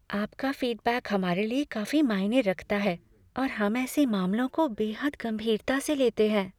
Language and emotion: Hindi, fearful